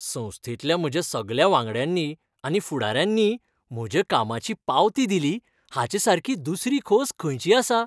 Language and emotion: Goan Konkani, happy